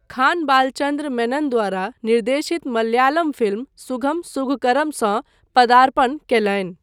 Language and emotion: Maithili, neutral